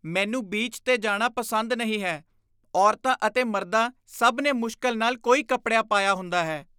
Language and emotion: Punjabi, disgusted